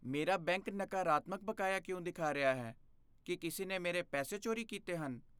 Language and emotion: Punjabi, fearful